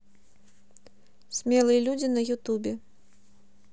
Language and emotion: Russian, neutral